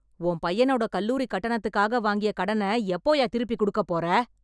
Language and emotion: Tamil, angry